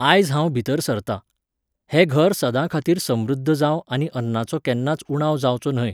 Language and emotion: Goan Konkani, neutral